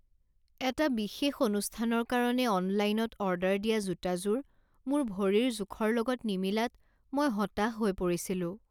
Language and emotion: Assamese, sad